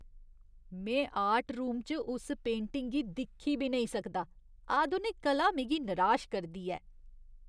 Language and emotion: Dogri, disgusted